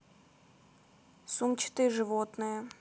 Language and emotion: Russian, neutral